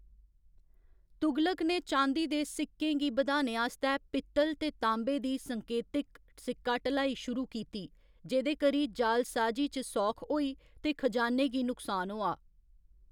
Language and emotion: Dogri, neutral